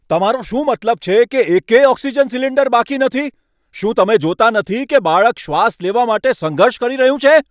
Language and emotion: Gujarati, angry